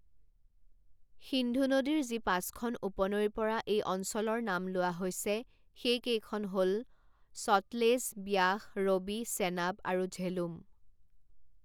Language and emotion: Assamese, neutral